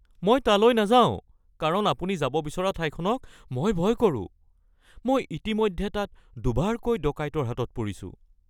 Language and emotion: Assamese, fearful